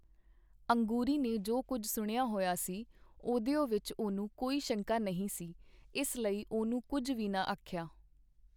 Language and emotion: Punjabi, neutral